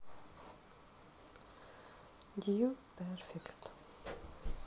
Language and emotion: Russian, neutral